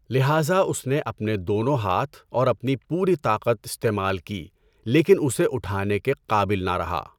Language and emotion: Urdu, neutral